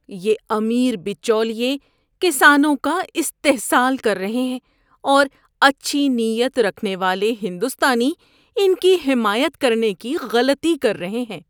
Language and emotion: Urdu, disgusted